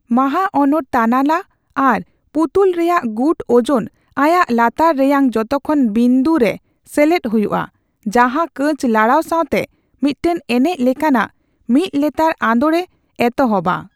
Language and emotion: Santali, neutral